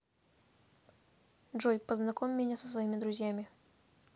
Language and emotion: Russian, neutral